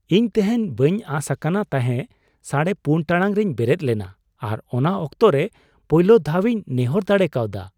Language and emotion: Santali, surprised